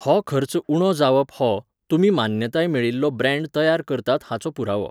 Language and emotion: Goan Konkani, neutral